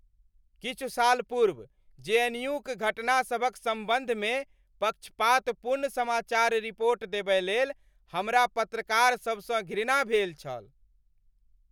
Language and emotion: Maithili, angry